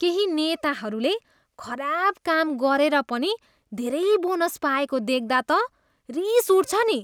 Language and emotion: Nepali, disgusted